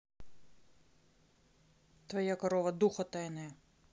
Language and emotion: Russian, neutral